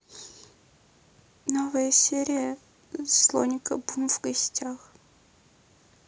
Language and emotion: Russian, sad